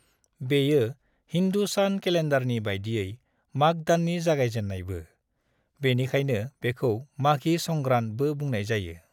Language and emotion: Bodo, neutral